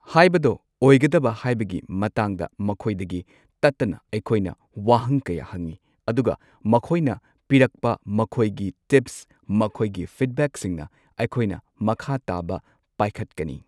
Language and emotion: Manipuri, neutral